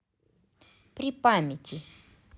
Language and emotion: Russian, positive